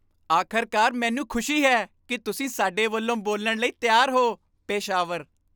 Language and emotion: Punjabi, happy